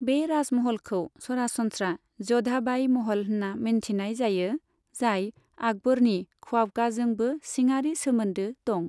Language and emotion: Bodo, neutral